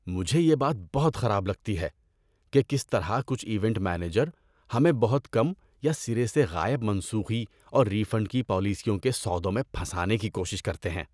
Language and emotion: Urdu, disgusted